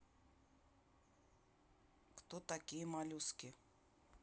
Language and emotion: Russian, neutral